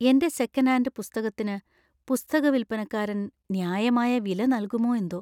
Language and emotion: Malayalam, fearful